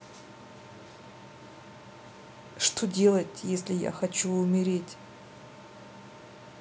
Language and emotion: Russian, sad